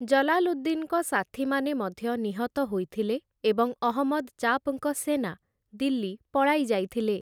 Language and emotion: Odia, neutral